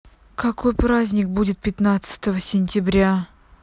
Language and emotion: Russian, angry